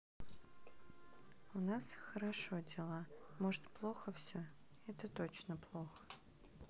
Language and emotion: Russian, sad